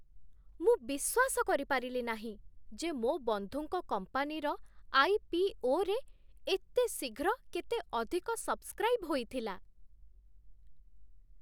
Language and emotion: Odia, surprised